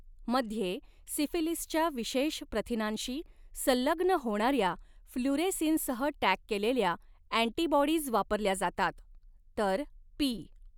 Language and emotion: Marathi, neutral